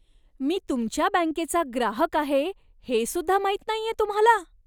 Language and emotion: Marathi, disgusted